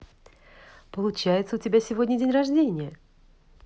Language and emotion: Russian, positive